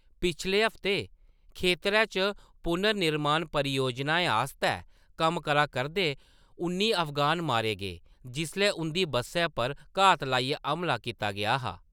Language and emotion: Dogri, neutral